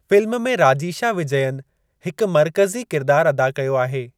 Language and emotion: Sindhi, neutral